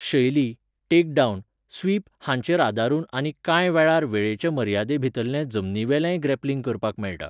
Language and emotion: Goan Konkani, neutral